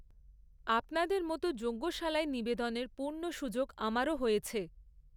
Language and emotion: Bengali, neutral